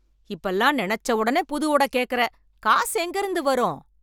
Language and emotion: Tamil, angry